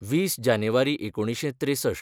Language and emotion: Goan Konkani, neutral